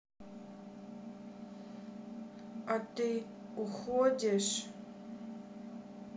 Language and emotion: Russian, sad